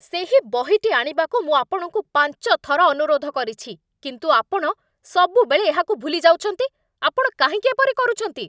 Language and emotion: Odia, angry